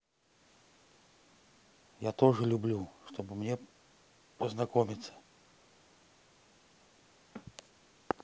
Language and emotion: Russian, neutral